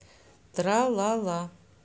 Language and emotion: Russian, neutral